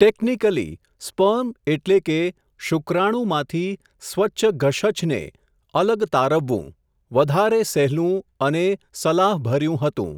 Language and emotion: Gujarati, neutral